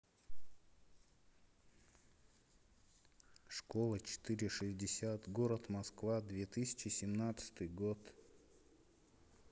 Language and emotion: Russian, neutral